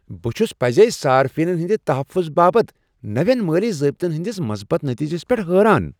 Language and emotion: Kashmiri, surprised